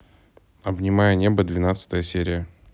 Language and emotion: Russian, neutral